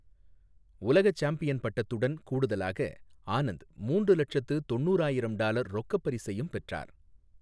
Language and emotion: Tamil, neutral